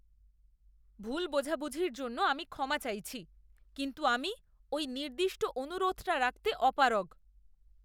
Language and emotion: Bengali, disgusted